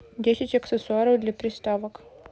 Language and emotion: Russian, neutral